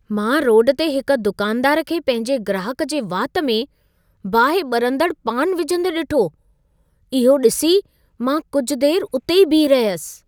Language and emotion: Sindhi, surprised